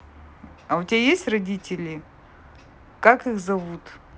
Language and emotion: Russian, neutral